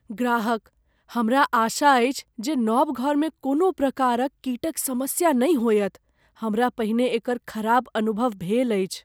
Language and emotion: Maithili, fearful